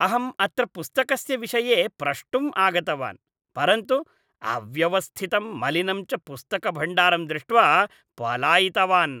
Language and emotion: Sanskrit, disgusted